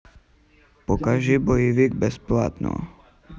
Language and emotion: Russian, neutral